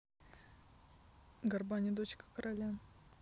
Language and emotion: Russian, neutral